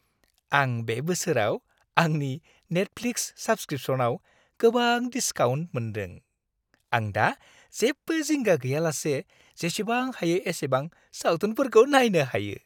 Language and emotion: Bodo, happy